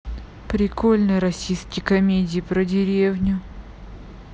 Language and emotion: Russian, neutral